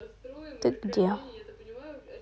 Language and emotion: Russian, neutral